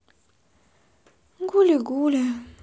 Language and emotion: Russian, sad